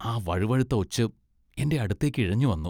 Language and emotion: Malayalam, disgusted